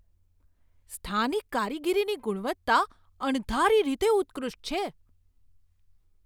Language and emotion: Gujarati, surprised